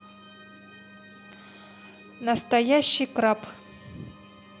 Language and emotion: Russian, neutral